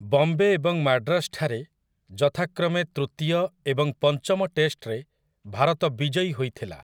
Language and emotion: Odia, neutral